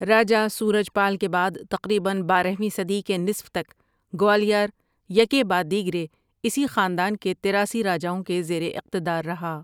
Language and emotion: Urdu, neutral